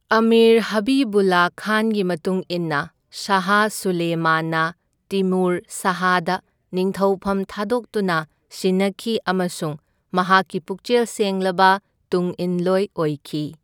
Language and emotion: Manipuri, neutral